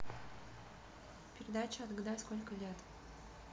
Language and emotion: Russian, neutral